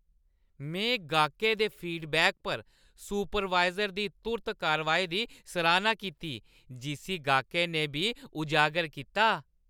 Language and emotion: Dogri, happy